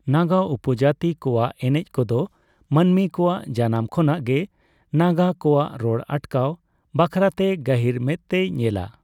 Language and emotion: Santali, neutral